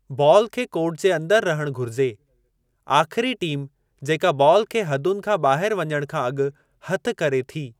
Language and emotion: Sindhi, neutral